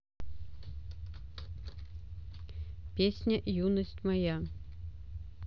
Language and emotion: Russian, neutral